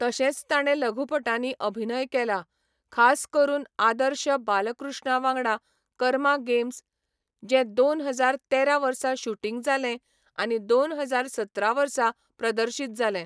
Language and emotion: Goan Konkani, neutral